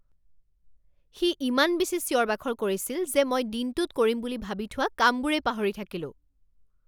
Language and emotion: Assamese, angry